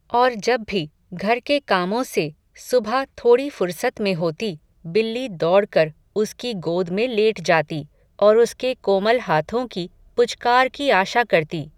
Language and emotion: Hindi, neutral